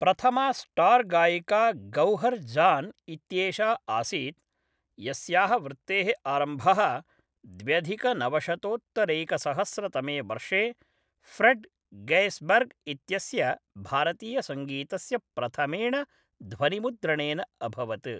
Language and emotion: Sanskrit, neutral